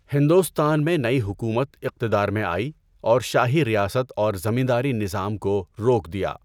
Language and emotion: Urdu, neutral